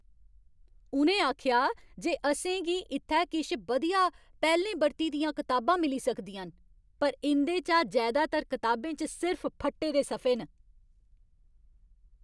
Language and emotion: Dogri, angry